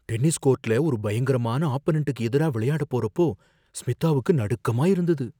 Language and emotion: Tamil, fearful